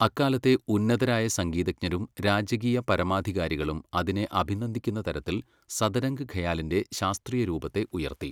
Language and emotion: Malayalam, neutral